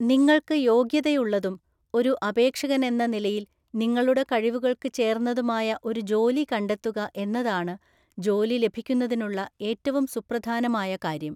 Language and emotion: Malayalam, neutral